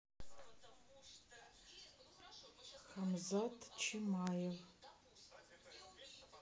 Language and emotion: Russian, neutral